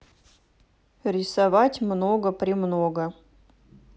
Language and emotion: Russian, neutral